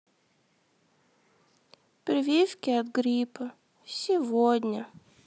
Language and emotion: Russian, sad